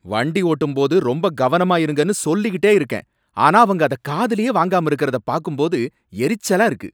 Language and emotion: Tamil, angry